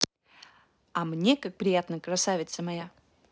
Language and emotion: Russian, positive